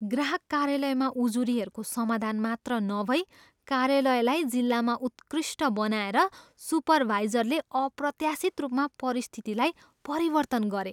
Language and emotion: Nepali, surprised